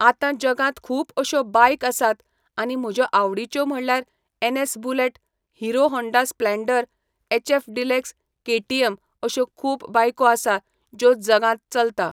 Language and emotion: Goan Konkani, neutral